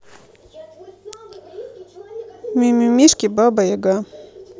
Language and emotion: Russian, neutral